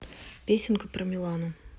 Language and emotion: Russian, neutral